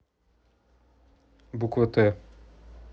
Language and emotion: Russian, neutral